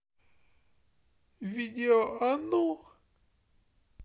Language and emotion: Russian, sad